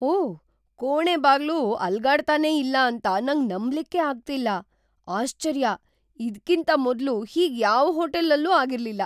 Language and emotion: Kannada, surprised